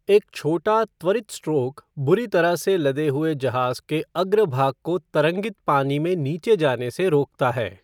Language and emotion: Hindi, neutral